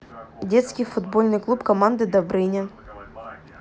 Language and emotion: Russian, neutral